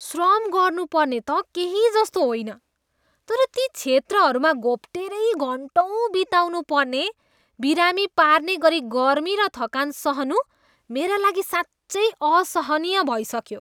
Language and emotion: Nepali, disgusted